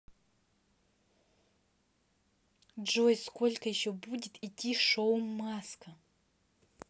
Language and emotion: Russian, angry